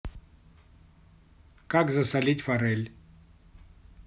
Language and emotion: Russian, neutral